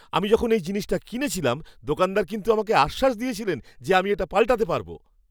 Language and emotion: Bengali, happy